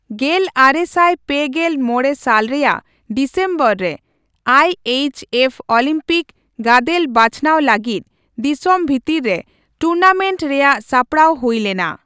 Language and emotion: Santali, neutral